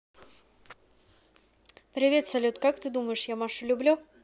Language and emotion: Russian, neutral